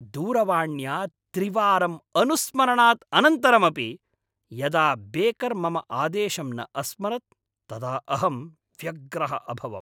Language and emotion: Sanskrit, angry